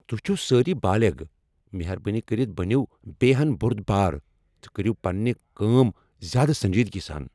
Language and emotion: Kashmiri, angry